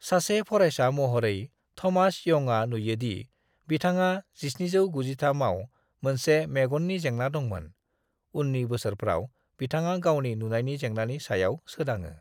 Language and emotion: Bodo, neutral